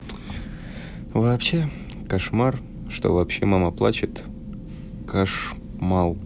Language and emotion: Russian, sad